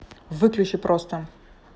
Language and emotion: Russian, angry